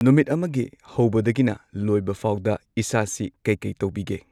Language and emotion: Manipuri, neutral